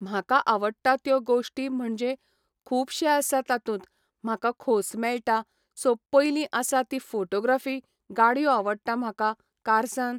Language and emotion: Goan Konkani, neutral